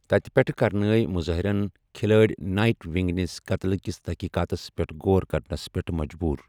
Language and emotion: Kashmiri, neutral